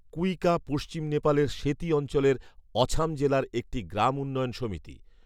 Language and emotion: Bengali, neutral